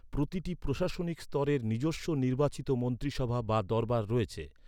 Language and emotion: Bengali, neutral